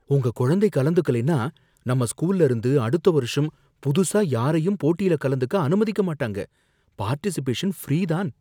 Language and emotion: Tamil, fearful